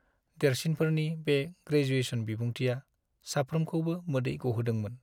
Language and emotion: Bodo, sad